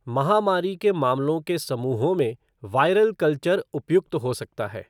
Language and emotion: Hindi, neutral